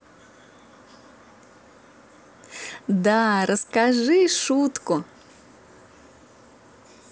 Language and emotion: Russian, positive